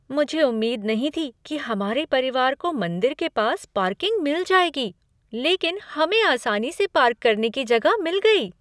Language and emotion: Hindi, surprised